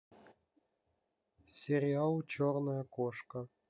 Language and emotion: Russian, neutral